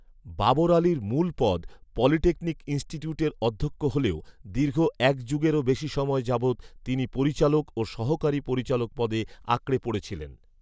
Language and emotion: Bengali, neutral